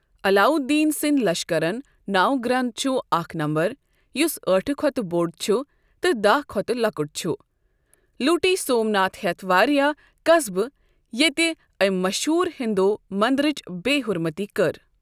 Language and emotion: Kashmiri, neutral